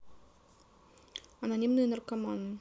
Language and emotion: Russian, neutral